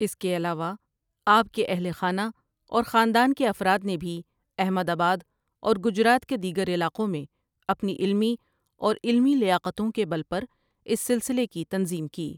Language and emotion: Urdu, neutral